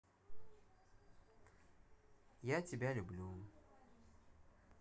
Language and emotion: Russian, neutral